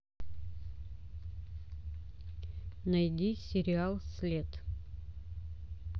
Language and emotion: Russian, neutral